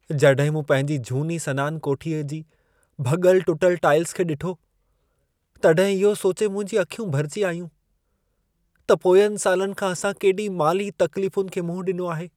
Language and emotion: Sindhi, sad